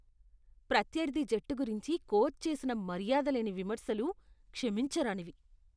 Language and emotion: Telugu, disgusted